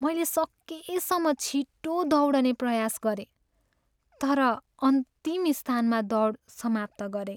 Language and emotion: Nepali, sad